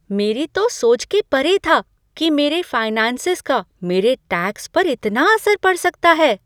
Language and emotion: Hindi, surprised